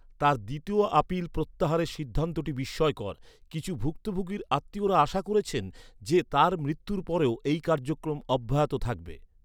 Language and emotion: Bengali, neutral